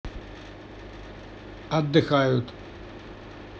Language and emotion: Russian, neutral